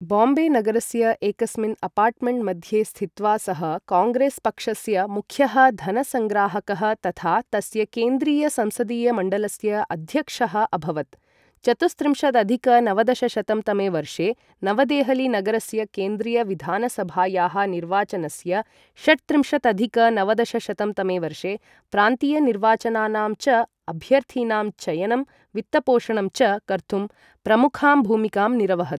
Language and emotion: Sanskrit, neutral